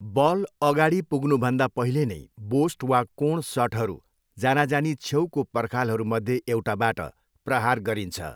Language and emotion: Nepali, neutral